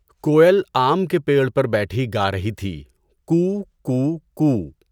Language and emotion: Urdu, neutral